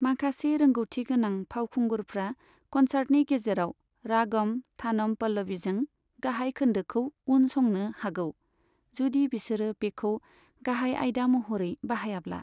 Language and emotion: Bodo, neutral